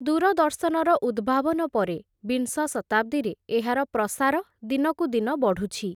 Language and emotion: Odia, neutral